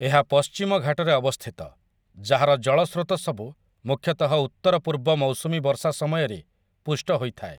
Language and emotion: Odia, neutral